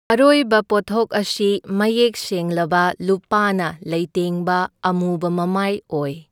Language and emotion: Manipuri, neutral